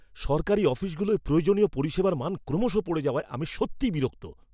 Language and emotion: Bengali, angry